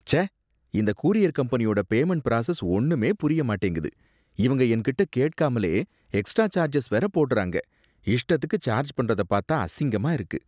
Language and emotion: Tamil, disgusted